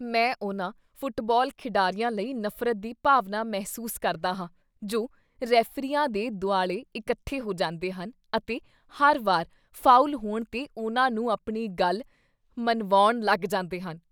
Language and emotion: Punjabi, disgusted